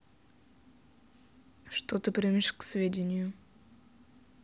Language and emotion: Russian, neutral